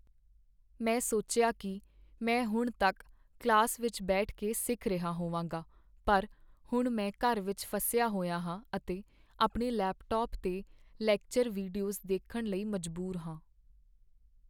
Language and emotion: Punjabi, sad